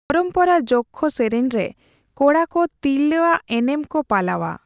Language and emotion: Santali, neutral